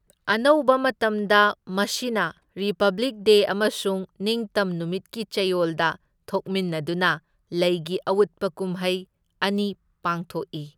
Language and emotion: Manipuri, neutral